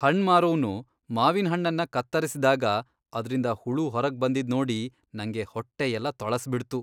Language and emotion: Kannada, disgusted